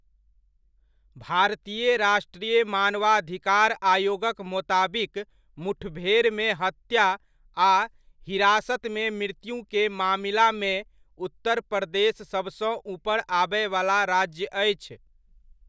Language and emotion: Maithili, neutral